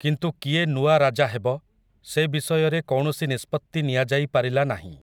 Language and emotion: Odia, neutral